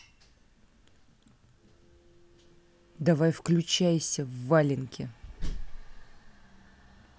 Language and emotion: Russian, angry